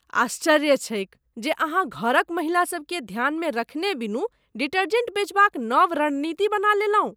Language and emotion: Maithili, disgusted